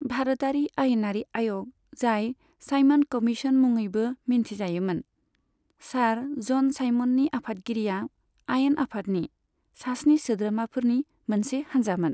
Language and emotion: Bodo, neutral